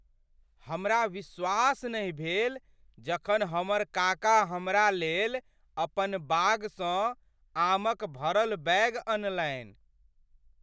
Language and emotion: Maithili, surprised